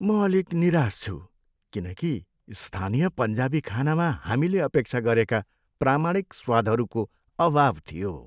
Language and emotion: Nepali, sad